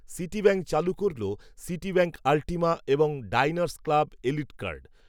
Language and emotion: Bengali, neutral